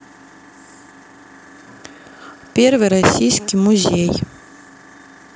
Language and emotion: Russian, neutral